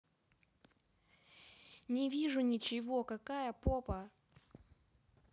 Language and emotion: Russian, neutral